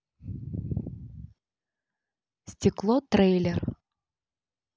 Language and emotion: Russian, neutral